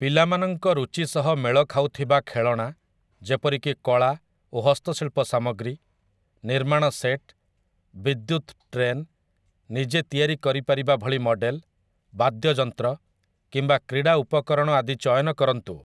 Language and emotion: Odia, neutral